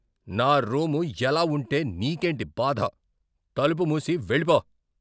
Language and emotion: Telugu, angry